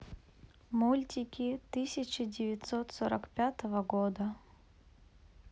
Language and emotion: Russian, neutral